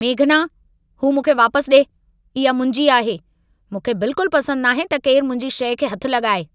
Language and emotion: Sindhi, angry